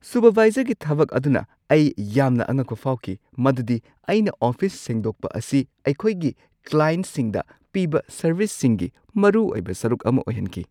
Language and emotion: Manipuri, surprised